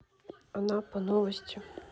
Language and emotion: Russian, neutral